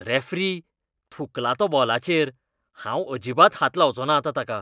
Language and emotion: Goan Konkani, disgusted